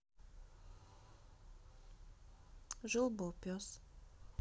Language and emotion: Russian, neutral